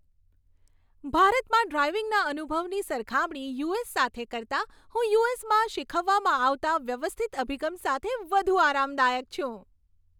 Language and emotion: Gujarati, happy